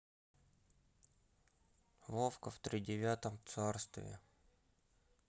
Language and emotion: Russian, sad